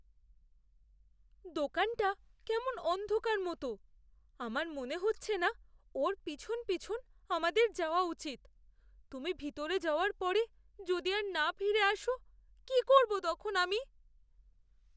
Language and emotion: Bengali, fearful